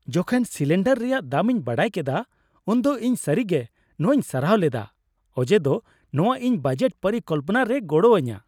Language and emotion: Santali, happy